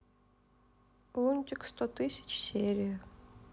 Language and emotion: Russian, sad